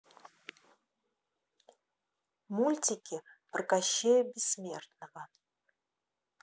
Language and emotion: Russian, neutral